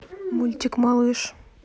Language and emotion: Russian, neutral